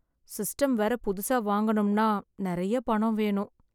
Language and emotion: Tamil, sad